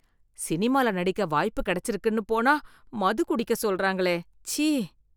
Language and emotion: Tamil, disgusted